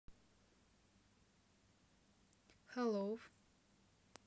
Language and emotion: Russian, neutral